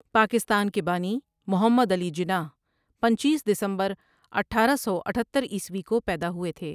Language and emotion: Urdu, neutral